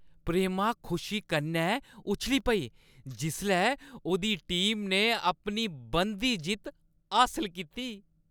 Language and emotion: Dogri, happy